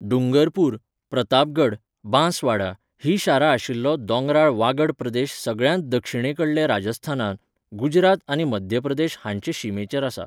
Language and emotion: Goan Konkani, neutral